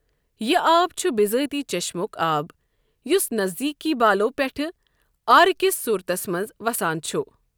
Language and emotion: Kashmiri, neutral